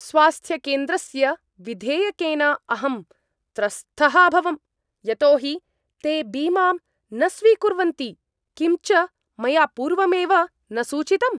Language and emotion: Sanskrit, angry